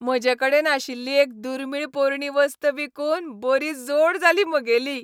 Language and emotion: Goan Konkani, happy